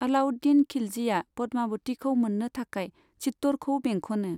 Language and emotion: Bodo, neutral